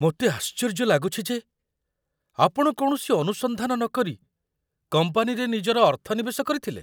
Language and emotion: Odia, surprised